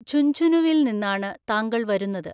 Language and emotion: Malayalam, neutral